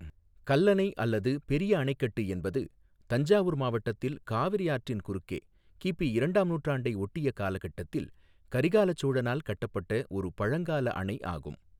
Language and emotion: Tamil, neutral